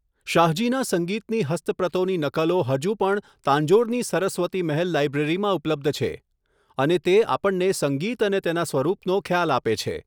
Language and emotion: Gujarati, neutral